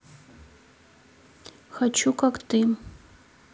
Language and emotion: Russian, neutral